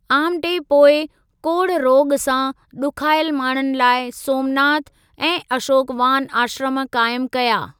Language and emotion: Sindhi, neutral